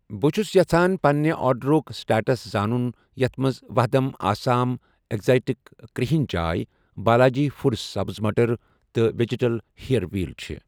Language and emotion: Kashmiri, neutral